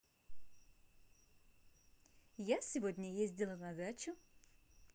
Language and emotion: Russian, positive